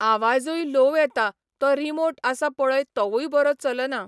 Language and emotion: Goan Konkani, neutral